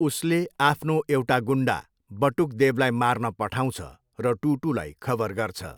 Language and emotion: Nepali, neutral